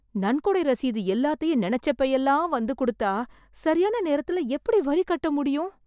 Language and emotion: Tamil, fearful